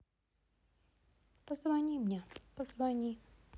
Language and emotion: Russian, sad